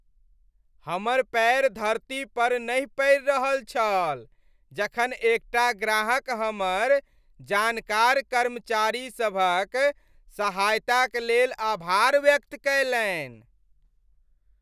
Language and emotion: Maithili, happy